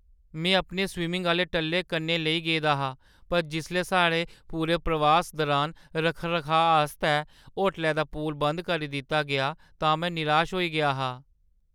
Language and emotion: Dogri, sad